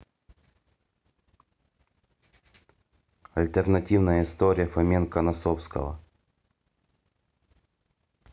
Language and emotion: Russian, neutral